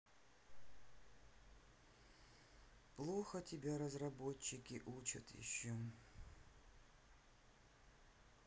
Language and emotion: Russian, sad